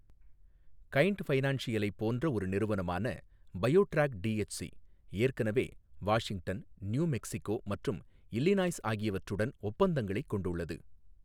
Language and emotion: Tamil, neutral